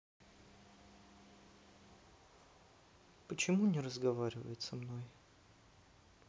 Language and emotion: Russian, sad